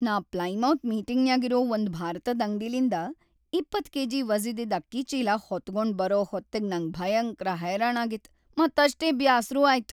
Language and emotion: Kannada, sad